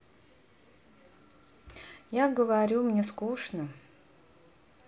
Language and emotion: Russian, sad